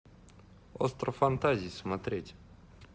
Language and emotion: Russian, neutral